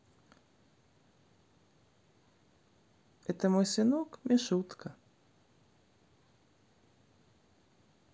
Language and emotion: Russian, neutral